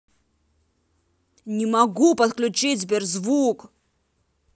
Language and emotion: Russian, angry